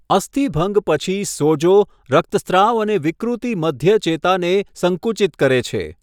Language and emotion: Gujarati, neutral